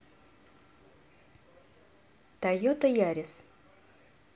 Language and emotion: Russian, neutral